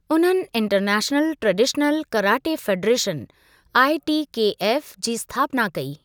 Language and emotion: Sindhi, neutral